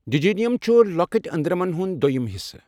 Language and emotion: Kashmiri, neutral